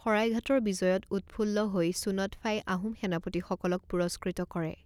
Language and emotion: Assamese, neutral